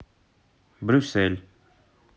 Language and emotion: Russian, neutral